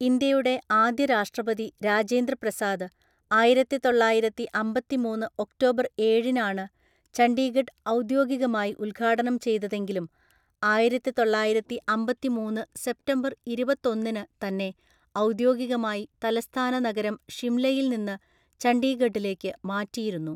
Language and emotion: Malayalam, neutral